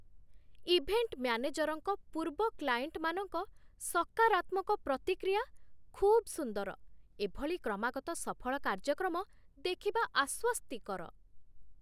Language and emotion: Odia, surprised